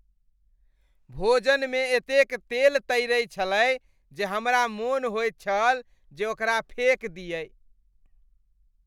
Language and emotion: Maithili, disgusted